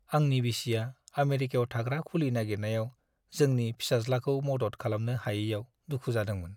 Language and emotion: Bodo, sad